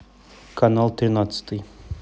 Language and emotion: Russian, neutral